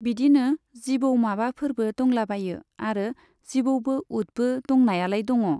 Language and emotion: Bodo, neutral